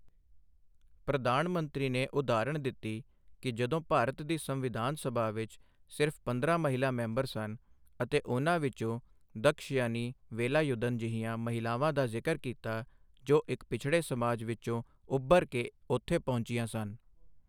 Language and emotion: Punjabi, neutral